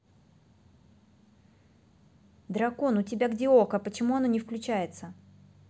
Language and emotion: Russian, neutral